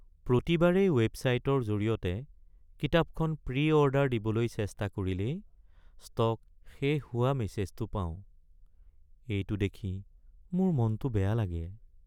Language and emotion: Assamese, sad